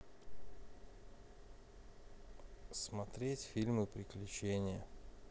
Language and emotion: Russian, neutral